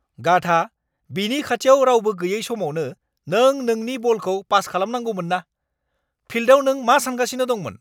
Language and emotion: Bodo, angry